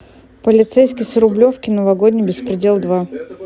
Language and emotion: Russian, neutral